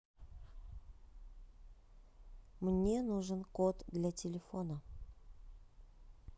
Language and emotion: Russian, neutral